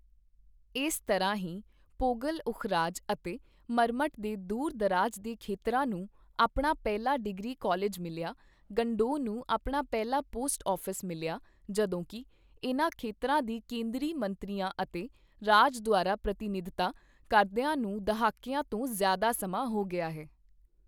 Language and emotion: Punjabi, neutral